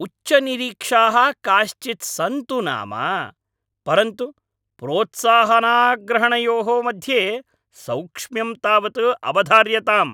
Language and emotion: Sanskrit, angry